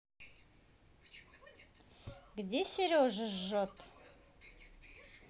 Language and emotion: Russian, neutral